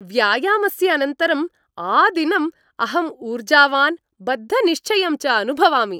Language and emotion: Sanskrit, happy